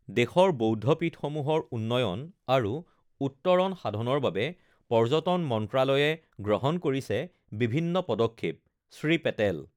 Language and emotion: Assamese, neutral